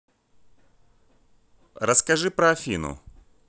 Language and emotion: Russian, neutral